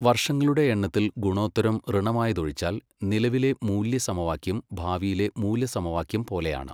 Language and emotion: Malayalam, neutral